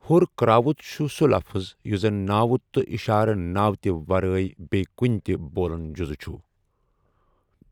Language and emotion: Kashmiri, neutral